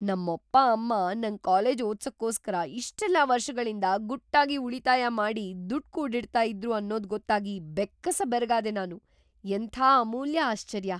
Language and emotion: Kannada, surprised